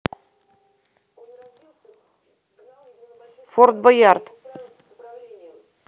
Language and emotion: Russian, neutral